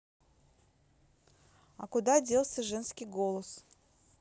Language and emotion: Russian, neutral